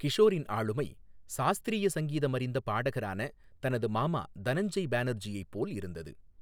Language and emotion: Tamil, neutral